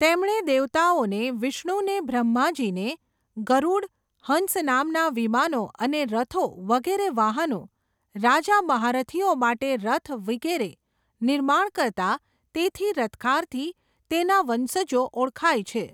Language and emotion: Gujarati, neutral